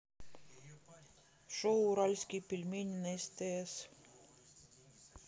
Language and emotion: Russian, neutral